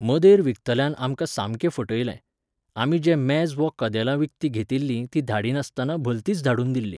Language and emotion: Goan Konkani, neutral